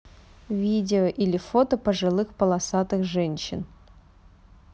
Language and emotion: Russian, neutral